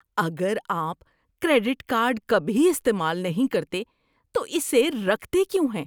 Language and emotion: Urdu, disgusted